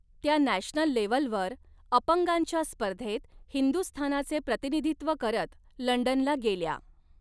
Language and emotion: Marathi, neutral